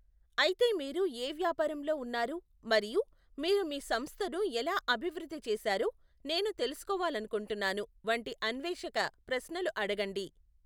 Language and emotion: Telugu, neutral